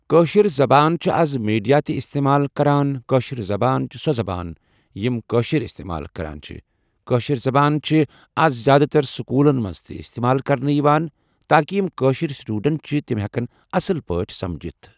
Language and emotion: Kashmiri, neutral